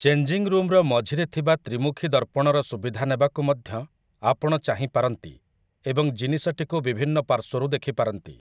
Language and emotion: Odia, neutral